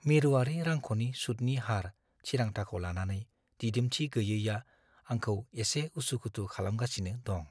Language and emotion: Bodo, fearful